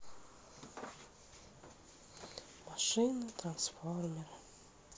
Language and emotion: Russian, sad